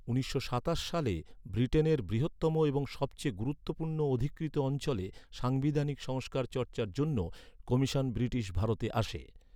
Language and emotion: Bengali, neutral